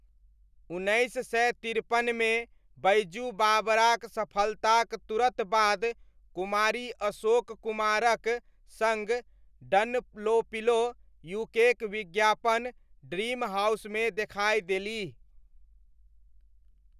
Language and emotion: Maithili, neutral